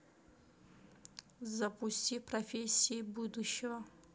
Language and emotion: Russian, neutral